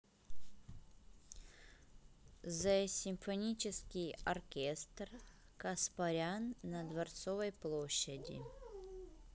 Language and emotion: Russian, neutral